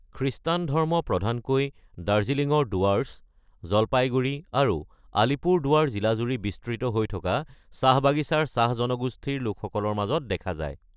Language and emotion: Assamese, neutral